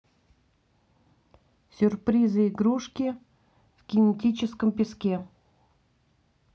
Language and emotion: Russian, neutral